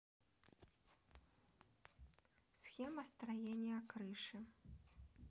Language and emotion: Russian, neutral